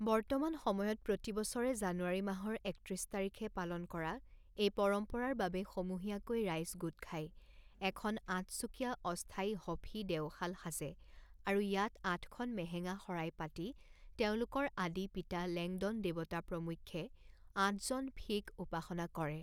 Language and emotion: Assamese, neutral